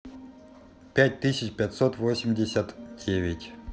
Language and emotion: Russian, neutral